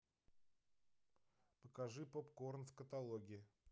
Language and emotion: Russian, neutral